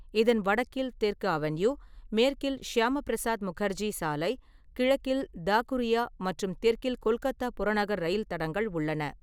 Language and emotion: Tamil, neutral